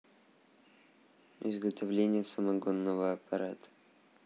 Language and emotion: Russian, neutral